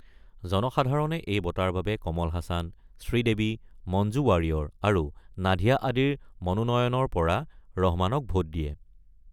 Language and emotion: Assamese, neutral